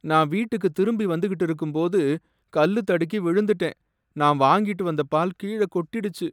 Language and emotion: Tamil, sad